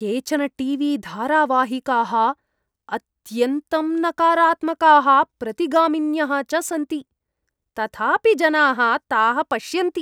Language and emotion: Sanskrit, disgusted